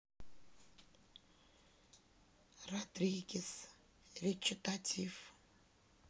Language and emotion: Russian, neutral